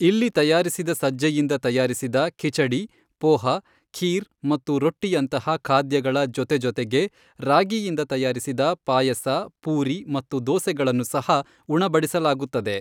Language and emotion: Kannada, neutral